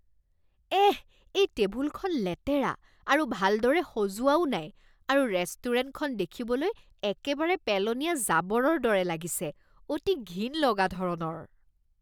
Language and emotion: Assamese, disgusted